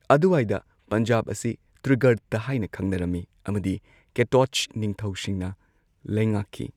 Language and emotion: Manipuri, neutral